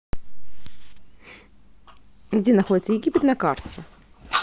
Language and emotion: Russian, neutral